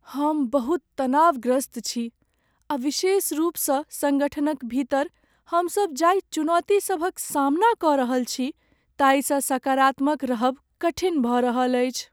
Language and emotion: Maithili, sad